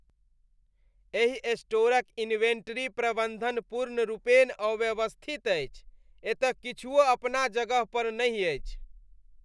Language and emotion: Maithili, disgusted